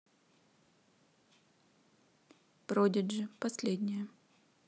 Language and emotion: Russian, neutral